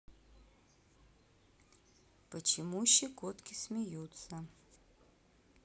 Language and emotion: Russian, neutral